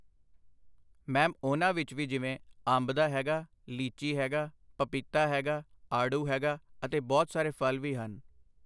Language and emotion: Punjabi, neutral